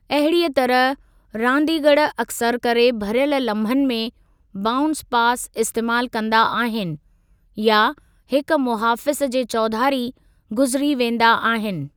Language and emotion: Sindhi, neutral